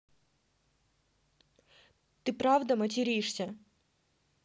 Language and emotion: Russian, neutral